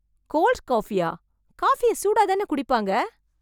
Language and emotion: Tamil, surprised